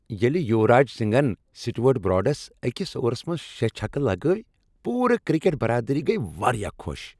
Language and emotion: Kashmiri, happy